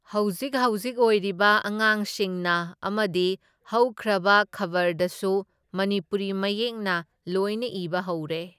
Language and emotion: Manipuri, neutral